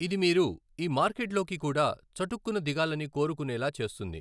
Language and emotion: Telugu, neutral